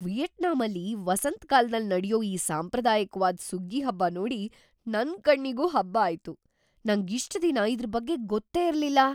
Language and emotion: Kannada, surprised